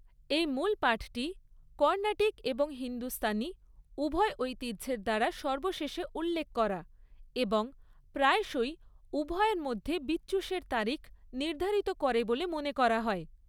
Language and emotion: Bengali, neutral